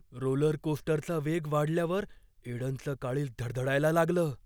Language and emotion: Marathi, fearful